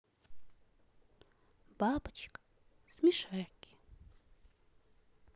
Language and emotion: Russian, positive